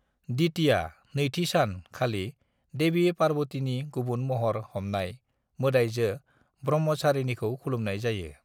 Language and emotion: Bodo, neutral